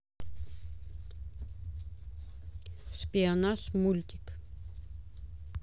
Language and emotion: Russian, neutral